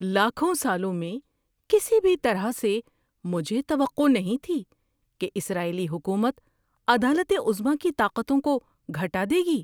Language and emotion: Urdu, surprised